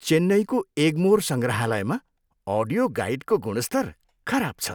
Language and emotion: Nepali, disgusted